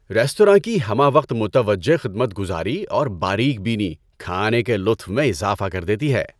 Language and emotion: Urdu, happy